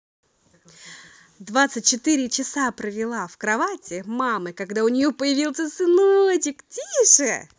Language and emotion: Russian, positive